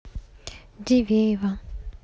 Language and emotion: Russian, neutral